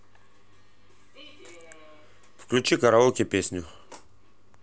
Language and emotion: Russian, neutral